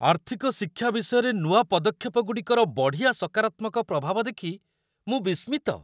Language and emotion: Odia, surprised